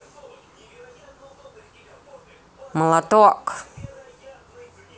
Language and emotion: Russian, positive